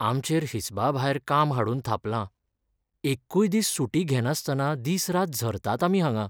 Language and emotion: Goan Konkani, sad